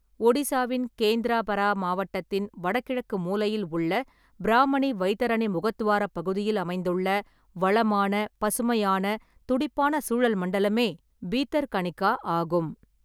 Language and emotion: Tamil, neutral